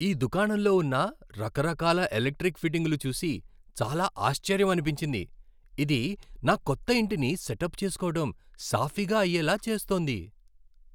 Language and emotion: Telugu, happy